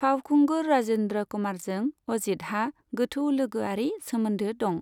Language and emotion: Bodo, neutral